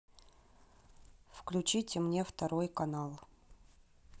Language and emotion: Russian, neutral